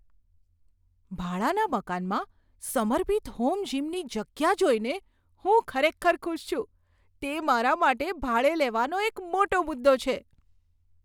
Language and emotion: Gujarati, surprised